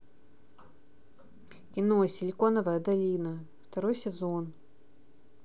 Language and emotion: Russian, neutral